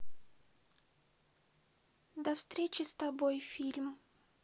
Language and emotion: Russian, sad